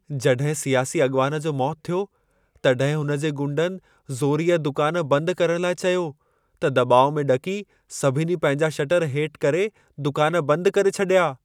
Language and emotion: Sindhi, fearful